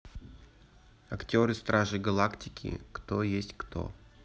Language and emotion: Russian, neutral